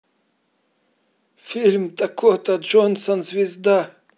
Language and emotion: Russian, neutral